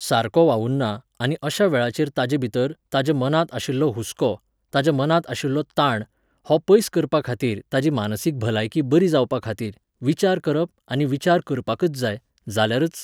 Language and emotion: Goan Konkani, neutral